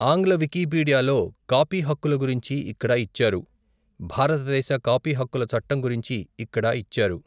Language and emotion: Telugu, neutral